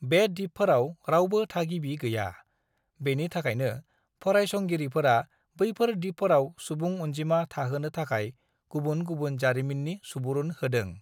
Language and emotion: Bodo, neutral